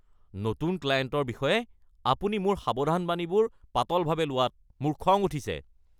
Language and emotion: Assamese, angry